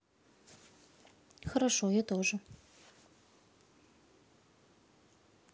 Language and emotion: Russian, neutral